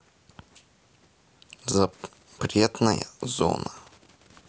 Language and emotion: Russian, neutral